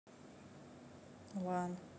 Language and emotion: Russian, neutral